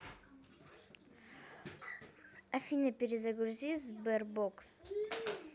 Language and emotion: Russian, neutral